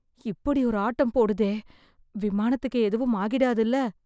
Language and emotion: Tamil, fearful